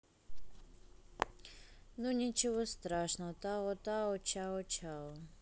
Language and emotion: Russian, neutral